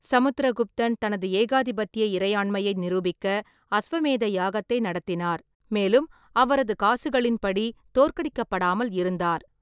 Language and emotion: Tamil, neutral